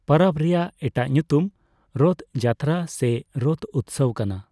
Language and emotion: Santali, neutral